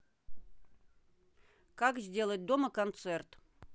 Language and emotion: Russian, neutral